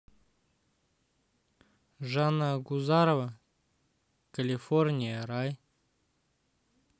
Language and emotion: Russian, neutral